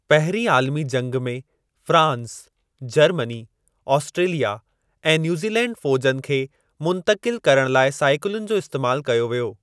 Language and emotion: Sindhi, neutral